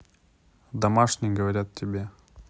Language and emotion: Russian, neutral